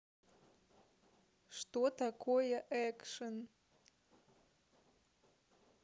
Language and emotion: Russian, neutral